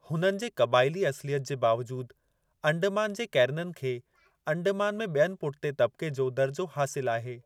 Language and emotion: Sindhi, neutral